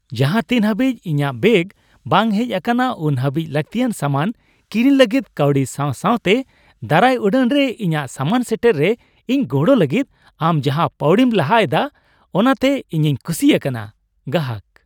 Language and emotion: Santali, happy